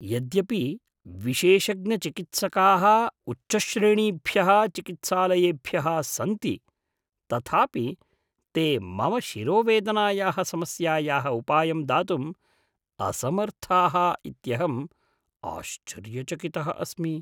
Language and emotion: Sanskrit, surprised